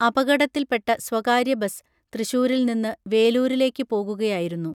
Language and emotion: Malayalam, neutral